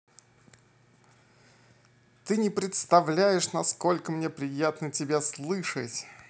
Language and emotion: Russian, positive